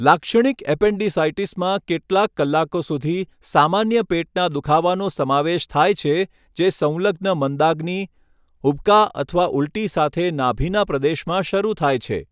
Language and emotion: Gujarati, neutral